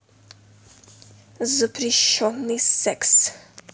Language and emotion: Russian, neutral